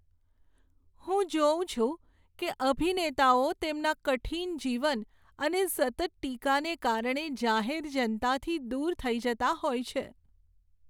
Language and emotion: Gujarati, sad